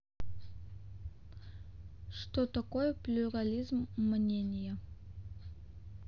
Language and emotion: Russian, neutral